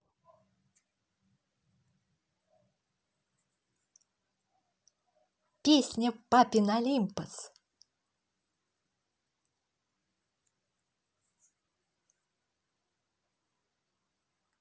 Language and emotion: Russian, positive